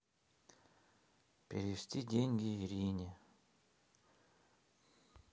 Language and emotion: Russian, neutral